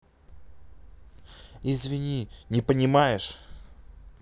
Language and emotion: Russian, angry